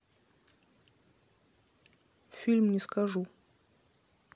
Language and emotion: Russian, neutral